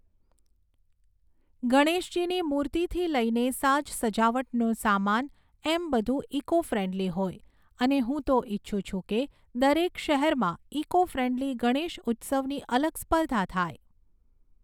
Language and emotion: Gujarati, neutral